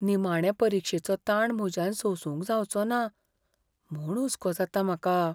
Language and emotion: Goan Konkani, fearful